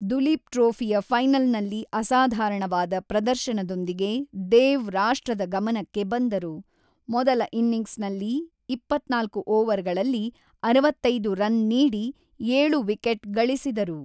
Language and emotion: Kannada, neutral